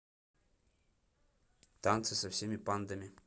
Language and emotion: Russian, neutral